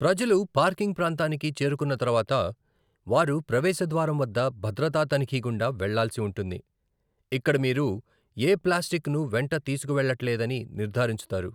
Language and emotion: Telugu, neutral